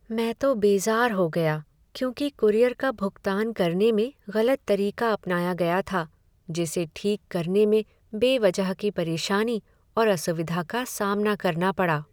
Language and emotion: Hindi, sad